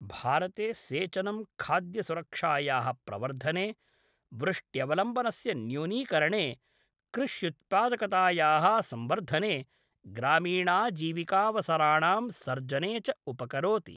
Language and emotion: Sanskrit, neutral